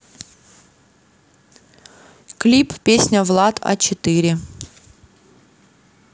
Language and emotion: Russian, neutral